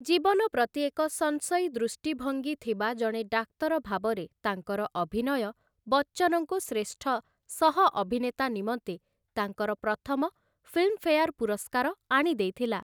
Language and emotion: Odia, neutral